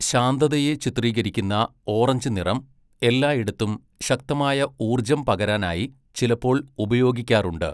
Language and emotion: Malayalam, neutral